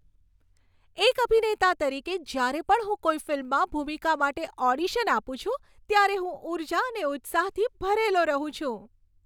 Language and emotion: Gujarati, happy